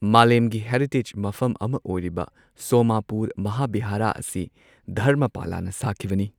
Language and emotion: Manipuri, neutral